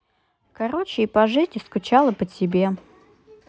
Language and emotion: Russian, neutral